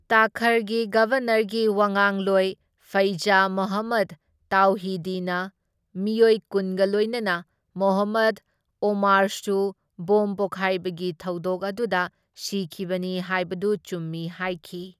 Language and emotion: Manipuri, neutral